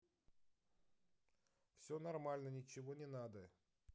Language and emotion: Russian, neutral